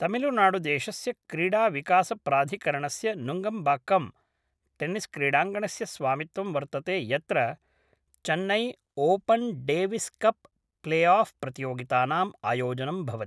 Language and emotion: Sanskrit, neutral